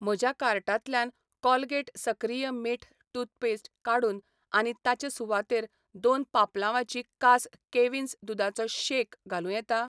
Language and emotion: Goan Konkani, neutral